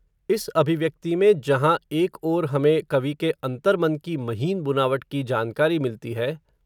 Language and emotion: Hindi, neutral